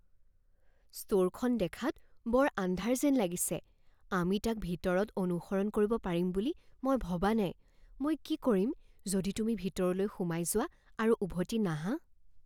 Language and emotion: Assamese, fearful